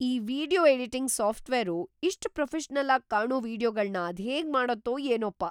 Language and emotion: Kannada, surprised